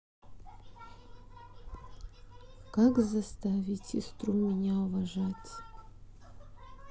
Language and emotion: Russian, sad